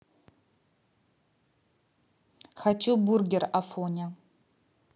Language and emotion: Russian, neutral